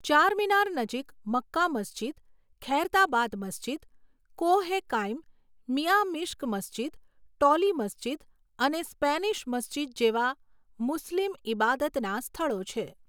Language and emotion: Gujarati, neutral